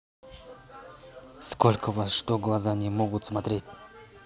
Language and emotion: Russian, angry